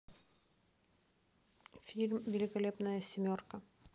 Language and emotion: Russian, neutral